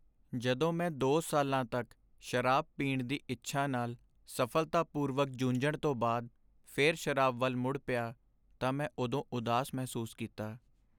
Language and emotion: Punjabi, sad